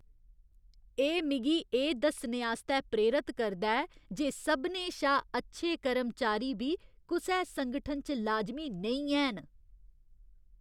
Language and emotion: Dogri, disgusted